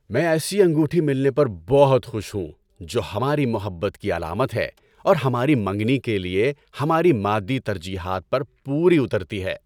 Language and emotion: Urdu, happy